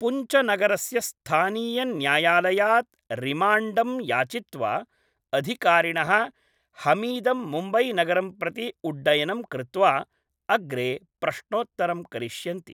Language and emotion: Sanskrit, neutral